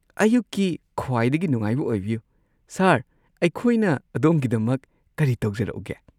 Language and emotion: Manipuri, happy